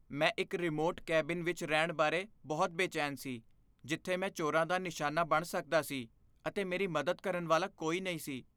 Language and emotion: Punjabi, fearful